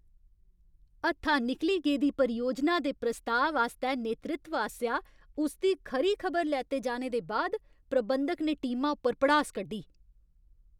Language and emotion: Dogri, angry